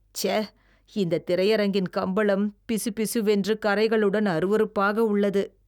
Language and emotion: Tamil, disgusted